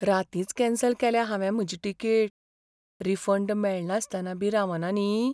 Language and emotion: Goan Konkani, fearful